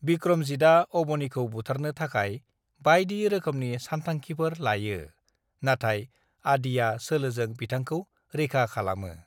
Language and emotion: Bodo, neutral